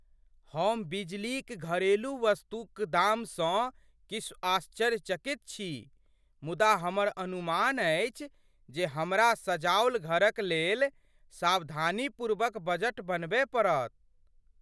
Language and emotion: Maithili, surprised